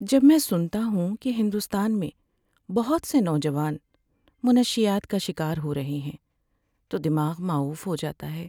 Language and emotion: Urdu, sad